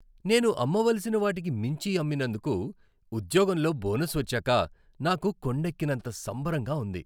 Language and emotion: Telugu, happy